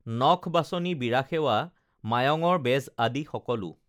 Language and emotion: Assamese, neutral